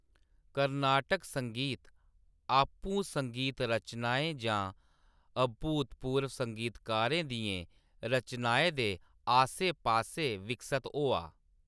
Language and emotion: Dogri, neutral